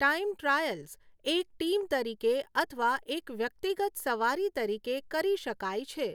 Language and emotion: Gujarati, neutral